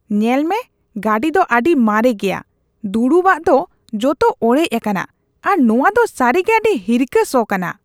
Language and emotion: Santali, disgusted